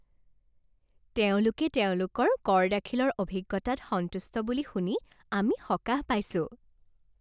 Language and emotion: Assamese, happy